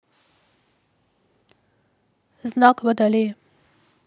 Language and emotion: Russian, neutral